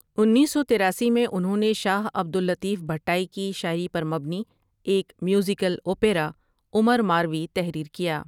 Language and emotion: Urdu, neutral